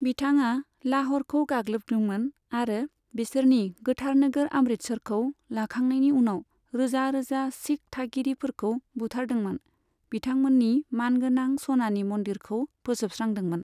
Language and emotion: Bodo, neutral